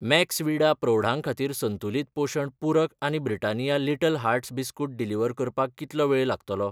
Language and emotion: Goan Konkani, neutral